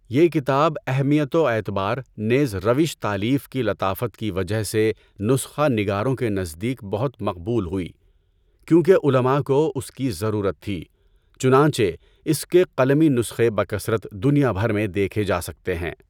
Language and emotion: Urdu, neutral